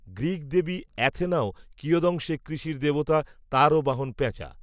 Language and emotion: Bengali, neutral